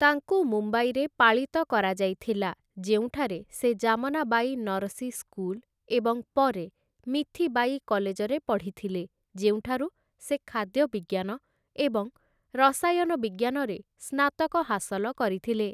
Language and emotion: Odia, neutral